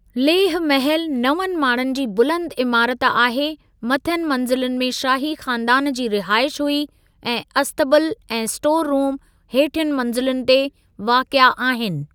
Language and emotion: Sindhi, neutral